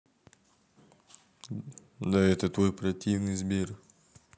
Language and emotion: Russian, neutral